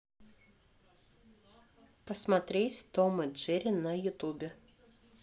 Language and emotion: Russian, neutral